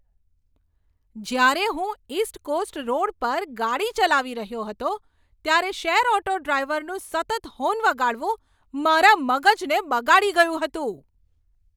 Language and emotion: Gujarati, angry